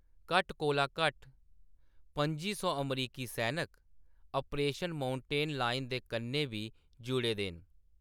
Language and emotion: Dogri, neutral